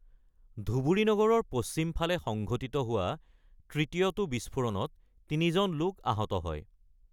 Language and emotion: Assamese, neutral